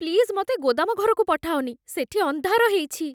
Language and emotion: Odia, fearful